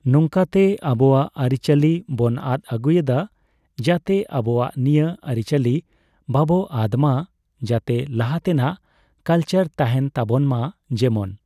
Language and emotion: Santali, neutral